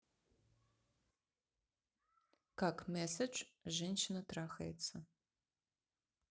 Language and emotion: Russian, neutral